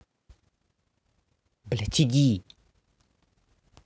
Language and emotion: Russian, angry